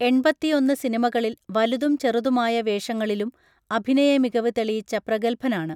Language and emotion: Malayalam, neutral